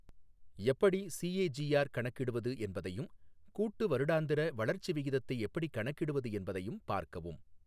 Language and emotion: Tamil, neutral